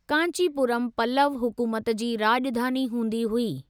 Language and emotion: Sindhi, neutral